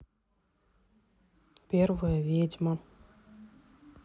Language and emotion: Russian, neutral